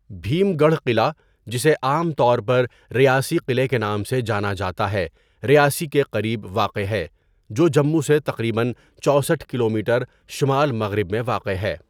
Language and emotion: Urdu, neutral